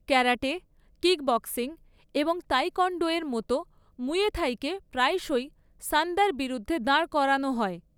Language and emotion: Bengali, neutral